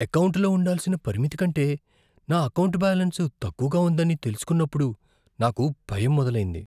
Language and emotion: Telugu, fearful